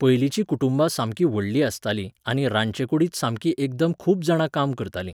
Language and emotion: Goan Konkani, neutral